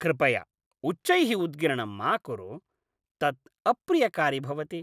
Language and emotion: Sanskrit, disgusted